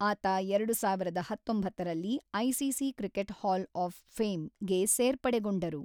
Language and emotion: Kannada, neutral